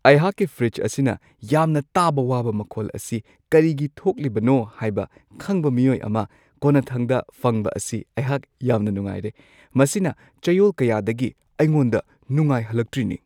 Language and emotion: Manipuri, happy